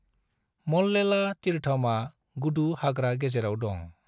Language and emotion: Bodo, neutral